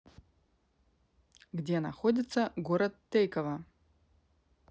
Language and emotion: Russian, neutral